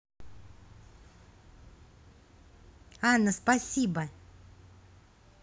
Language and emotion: Russian, positive